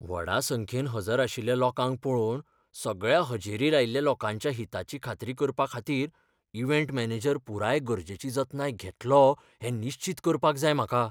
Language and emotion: Goan Konkani, fearful